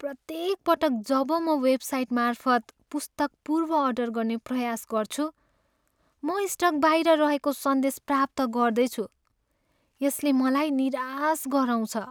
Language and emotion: Nepali, sad